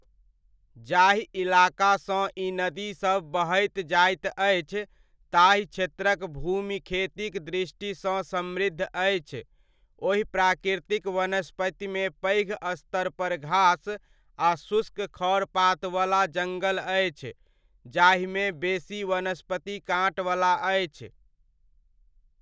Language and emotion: Maithili, neutral